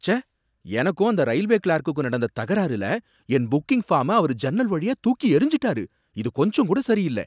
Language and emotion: Tamil, angry